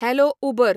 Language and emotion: Goan Konkani, neutral